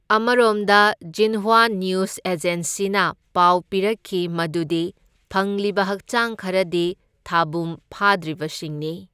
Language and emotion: Manipuri, neutral